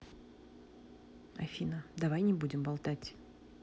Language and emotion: Russian, neutral